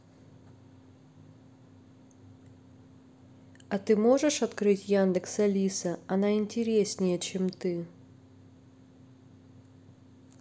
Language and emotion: Russian, neutral